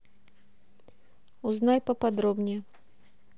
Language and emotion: Russian, neutral